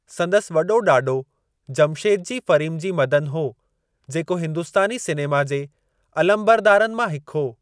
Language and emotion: Sindhi, neutral